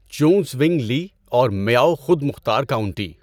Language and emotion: Urdu, neutral